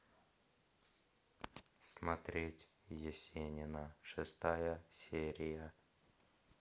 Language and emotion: Russian, neutral